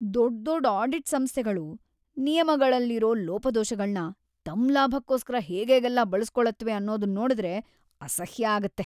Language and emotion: Kannada, disgusted